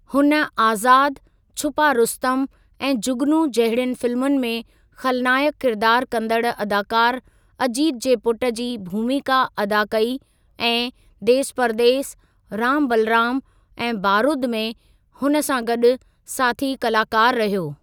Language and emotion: Sindhi, neutral